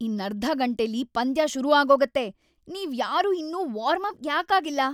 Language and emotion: Kannada, angry